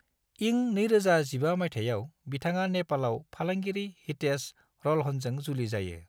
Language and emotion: Bodo, neutral